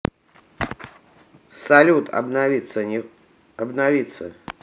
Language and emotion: Russian, neutral